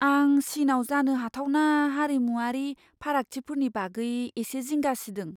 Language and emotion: Bodo, fearful